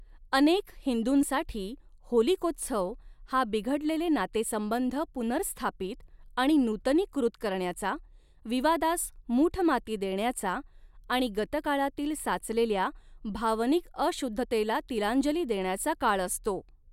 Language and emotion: Marathi, neutral